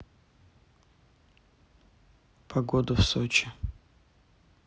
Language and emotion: Russian, neutral